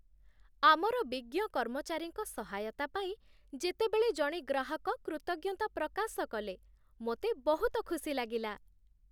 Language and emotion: Odia, happy